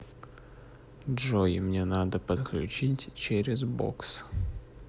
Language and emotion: Russian, neutral